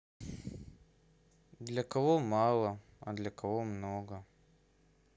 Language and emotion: Russian, sad